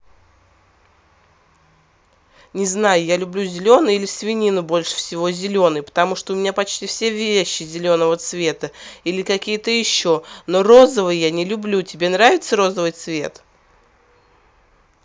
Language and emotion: Russian, angry